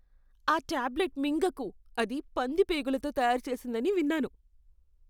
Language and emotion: Telugu, disgusted